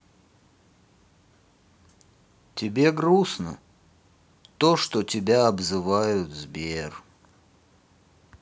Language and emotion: Russian, sad